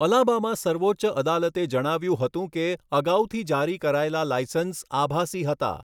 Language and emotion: Gujarati, neutral